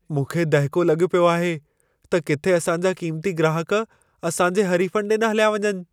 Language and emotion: Sindhi, fearful